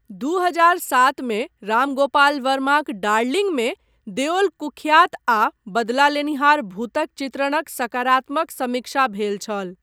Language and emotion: Maithili, neutral